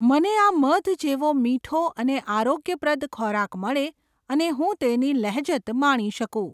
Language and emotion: Gujarati, neutral